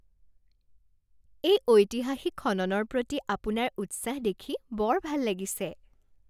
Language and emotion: Assamese, happy